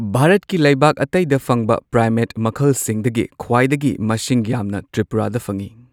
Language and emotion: Manipuri, neutral